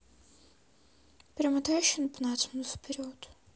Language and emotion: Russian, neutral